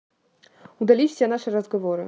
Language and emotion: Russian, neutral